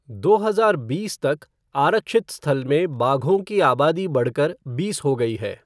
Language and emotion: Hindi, neutral